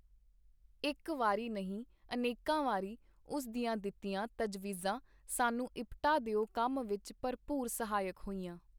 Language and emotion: Punjabi, neutral